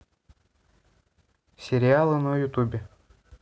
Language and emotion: Russian, neutral